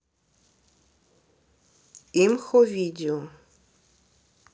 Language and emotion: Russian, neutral